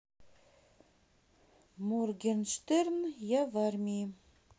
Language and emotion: Russian, neutral